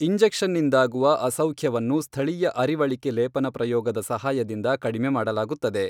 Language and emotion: Kannada, neutral